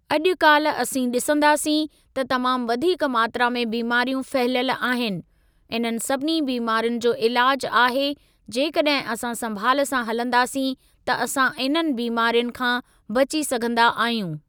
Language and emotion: Sindhi, neutral